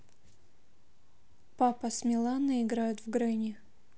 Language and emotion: Russian, neutral